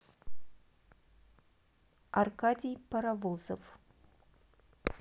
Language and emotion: Russian, neutral